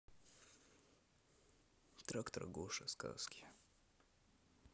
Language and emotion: Russian, neutral